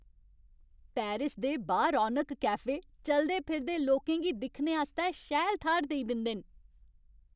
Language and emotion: Dogri, happy